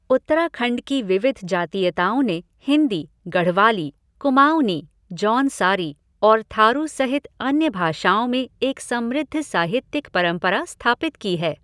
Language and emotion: Hindi, neutral